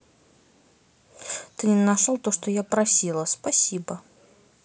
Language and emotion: Russian, neutral